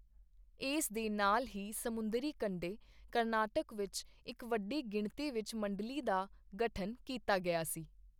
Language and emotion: Punjabi, neutral